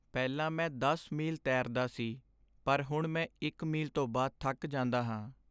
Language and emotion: Punjabi, sad